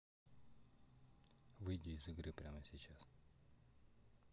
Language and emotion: Russian, neutral